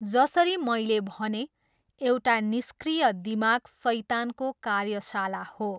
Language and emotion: Nepali, neutral